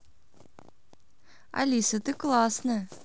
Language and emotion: Russian, positive